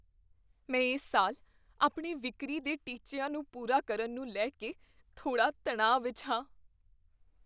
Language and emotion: Punjabi, fearful